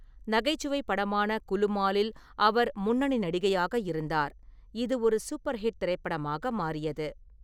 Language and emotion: Tamil, neutral